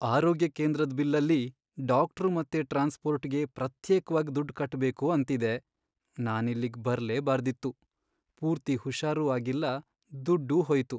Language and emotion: Kannada, sad